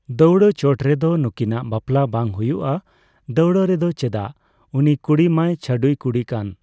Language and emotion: Santali, neutral